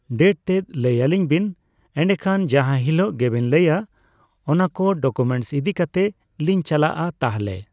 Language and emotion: Santali, neutral